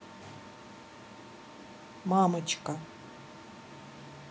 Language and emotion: Russian, neutral